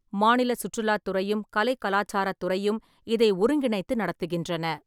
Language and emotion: Tamil, neutral